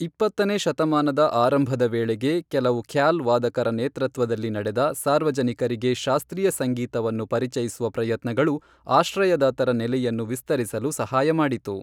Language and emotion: Kannada, neutral